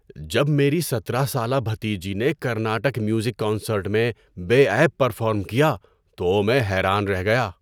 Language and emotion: Urdu, surprised